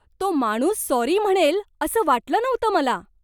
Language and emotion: Marathi, surprised